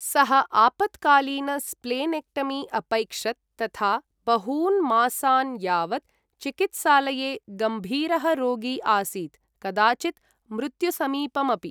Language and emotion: Sanskrit, neutral